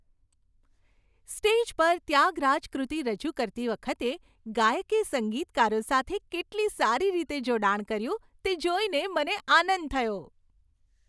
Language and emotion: Gujarati, happy